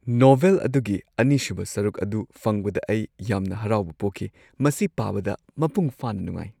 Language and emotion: Manipuri, happy